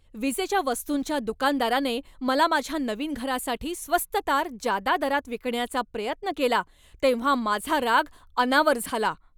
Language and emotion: Marathi, angry